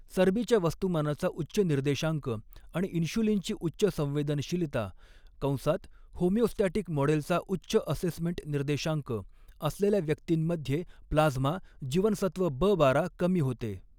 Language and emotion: Marathi, neutral